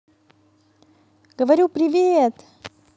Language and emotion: Russian, positive